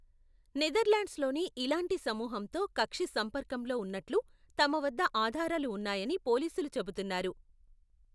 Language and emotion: Telugu, neutral